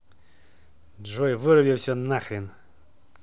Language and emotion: Russian, angry